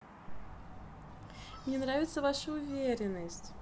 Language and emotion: Russian, positive